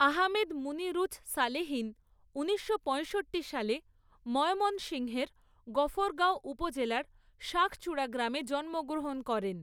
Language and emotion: Bengali, neutral